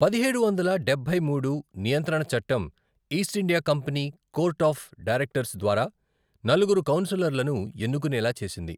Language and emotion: Telugu, neutral